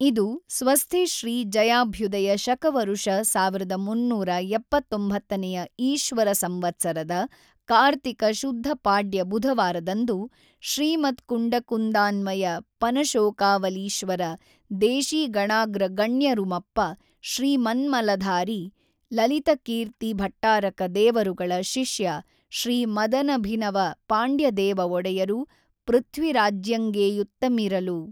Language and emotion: Kannada, neutral